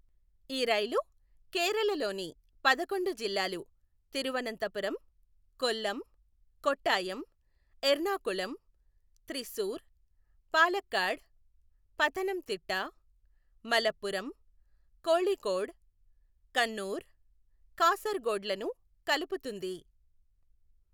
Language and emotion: Telugu, neutral